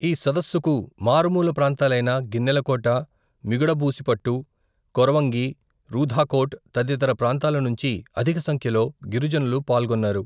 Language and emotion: Telugu, neutral